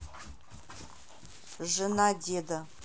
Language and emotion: Russian, neutral